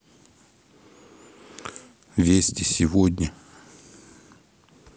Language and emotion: Russian, neutral